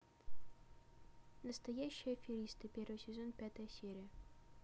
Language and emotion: Russian, neutral